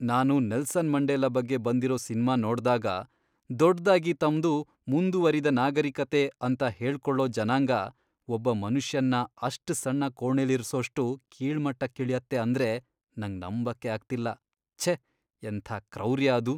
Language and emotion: Kannada, disgusted